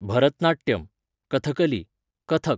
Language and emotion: Goan Konkani, neutral